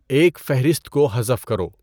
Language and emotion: Urdu, neutral